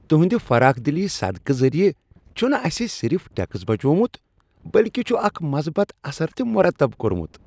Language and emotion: Kashmiri, happy